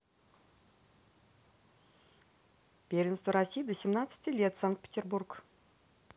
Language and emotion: Russian, neutral